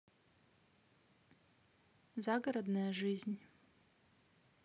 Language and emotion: Russian, neutral